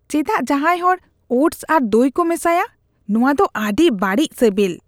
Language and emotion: Santali, disgusted